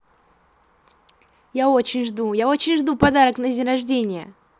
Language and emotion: Russian, positive